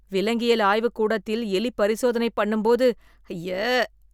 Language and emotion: Tamil, disgusted